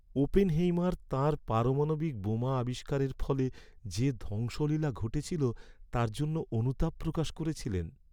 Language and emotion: Bengali, sad